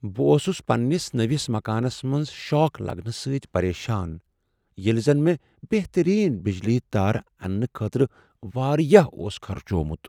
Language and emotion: Kashmiri, sad